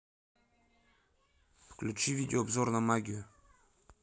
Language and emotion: Russian, neutral